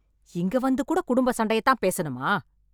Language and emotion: Tamil, angry